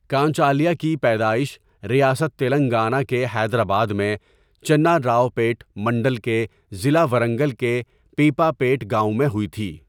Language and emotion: Urdu, neutral